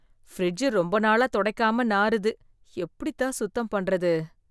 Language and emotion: Tamil, disgusted